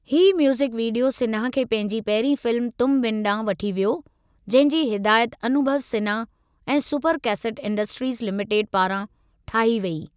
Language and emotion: Sindhi, neutral